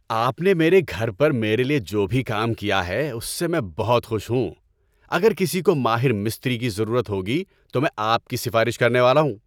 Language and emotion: Urdu, happy